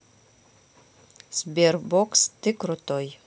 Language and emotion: Russian, neutral